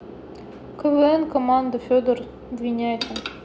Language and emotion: Russian, neutral